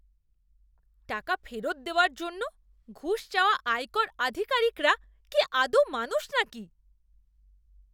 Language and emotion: Bengali, disgusted